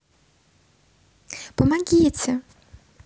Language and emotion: Russian, neutral